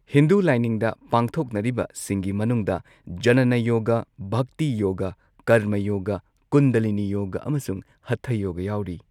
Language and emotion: Manipuri, neutral